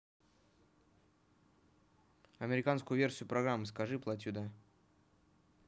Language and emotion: Russian, neutral